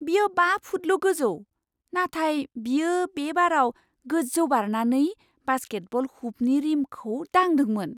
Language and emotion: Bodo, surprised